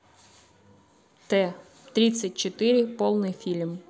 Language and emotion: Russian, neutral